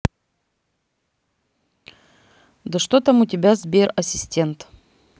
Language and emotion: Russian, neutral